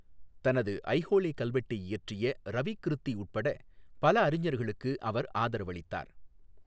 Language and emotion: Tamil, neutral